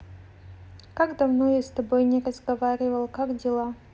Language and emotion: Russian, neutral